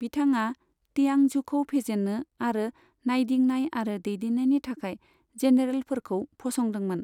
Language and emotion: Bodo, neutral